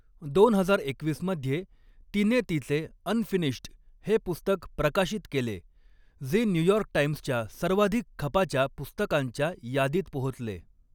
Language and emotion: Marathi, neutral